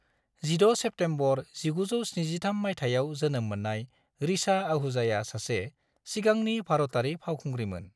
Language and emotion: Bodo, neutral